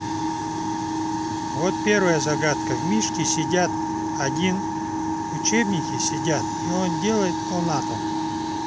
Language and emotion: Russian, neutral